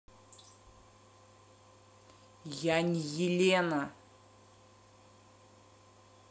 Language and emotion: Russian, angry